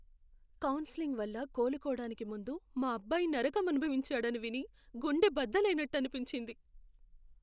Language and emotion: Telugu, sad